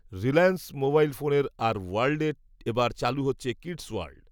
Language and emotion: Bengali, neutral